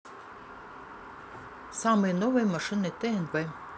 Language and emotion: Russian, neutral